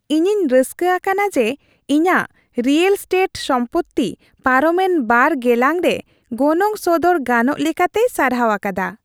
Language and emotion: Santali, happy